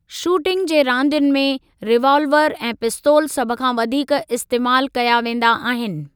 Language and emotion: Sindhi, neutral